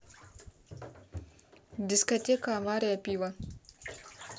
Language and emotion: Russian, neutral